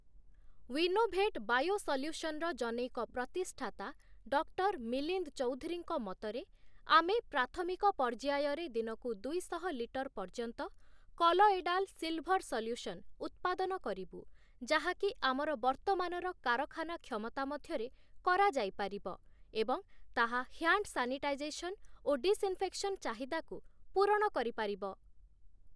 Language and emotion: Odia, neutral